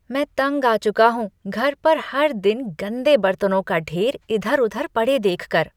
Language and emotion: Hindi, disgusted